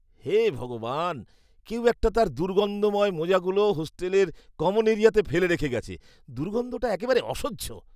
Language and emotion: Bengali, disgusted